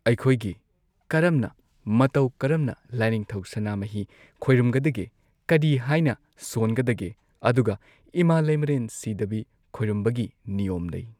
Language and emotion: Manipuri, neutral